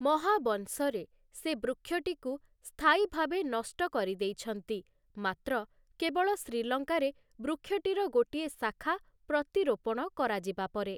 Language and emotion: Odia, neutral